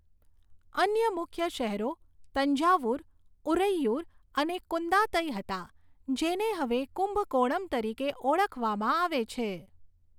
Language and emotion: Gujarati, neutral